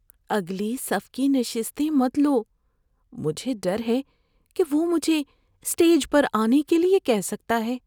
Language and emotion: Urdu, fearful